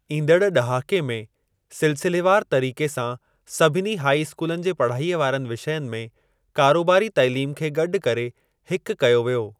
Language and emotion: Sindhi, neutral